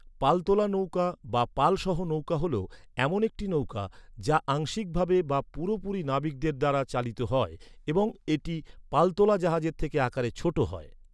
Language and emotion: Bengali, neutral